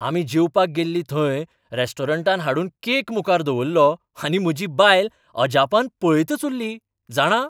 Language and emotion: Goan Konkani, surprised